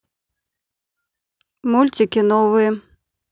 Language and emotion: Russian, neutral